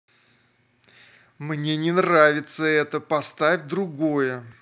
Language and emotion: Russian, angry